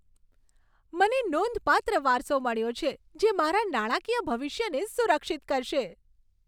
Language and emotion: Gujarati, happy